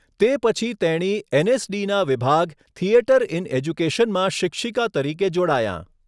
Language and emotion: Gujarati, neutral